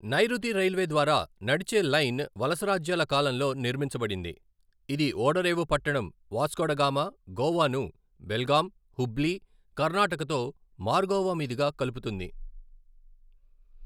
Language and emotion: Telugu, neutral